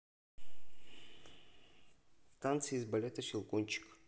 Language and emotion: Russian, neutral